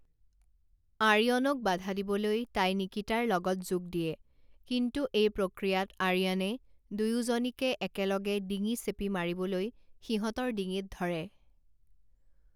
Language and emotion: Assamese, neutral